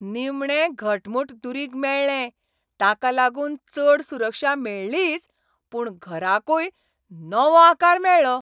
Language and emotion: Goan Konkani, happy